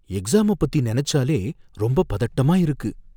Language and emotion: Tamil, fearful